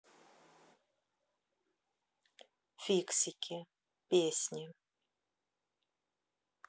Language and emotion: Russian, neutral